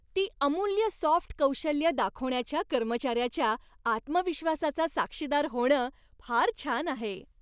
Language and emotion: Marathi, happy